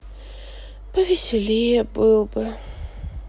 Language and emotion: Russian, sad